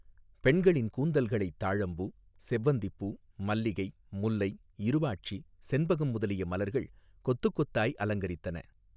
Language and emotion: Tamil, neutral